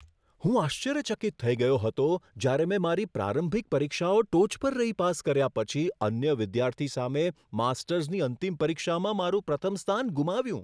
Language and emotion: Gujarati, surprised